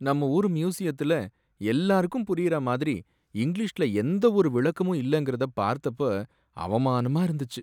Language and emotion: Tamil, sad